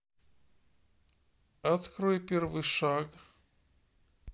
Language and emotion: Russian, neutral